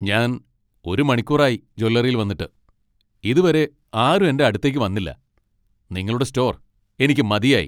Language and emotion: Malayalam, angry